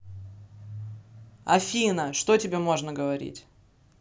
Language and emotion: Russian, angry